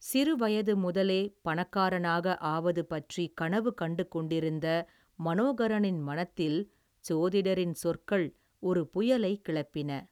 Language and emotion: Tamil, neutral